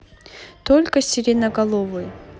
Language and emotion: Russian, neutral